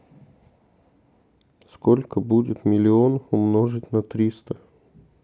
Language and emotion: Russian, neutral